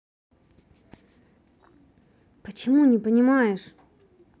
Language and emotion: Russian, angry